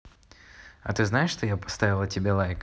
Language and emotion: Russian, neutral